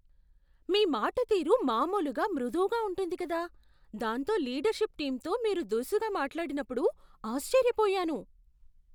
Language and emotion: Telugu, surprised